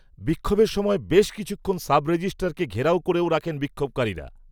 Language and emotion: Bengali, neutral